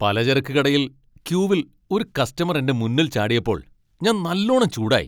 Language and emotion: Malayalam, angry